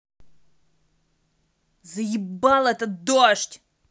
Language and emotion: Russian, angry